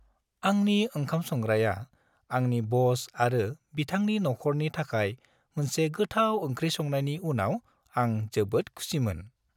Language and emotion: Bodo, happy